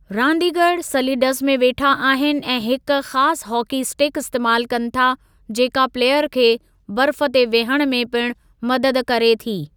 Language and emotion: Sindhi, neutral